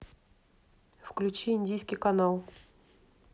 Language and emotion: Russian, neutral